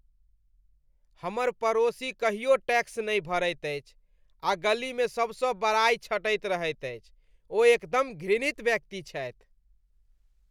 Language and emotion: Maithili, disgusted